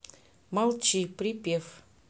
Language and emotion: Russian, neutral